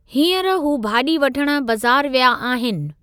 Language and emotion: Sindhi, neutral